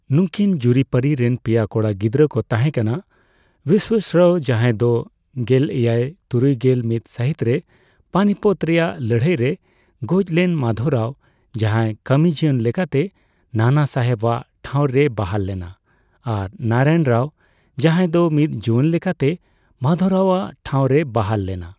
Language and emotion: Santali, neutral